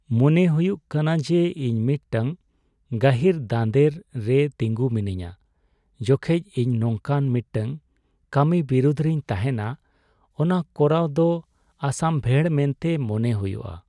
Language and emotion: Santali, sad